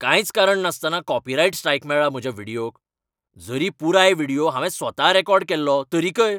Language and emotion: Goan Konkani, angry